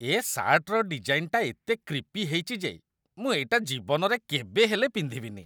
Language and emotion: Odia, disgusted